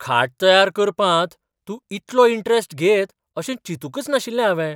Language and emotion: Goan Konkani, surprised